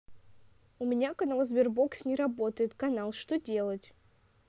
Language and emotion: Russian, neutral